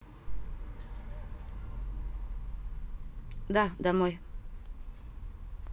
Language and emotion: Russian, neutral